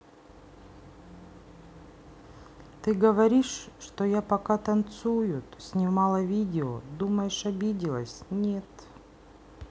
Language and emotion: Russian, sad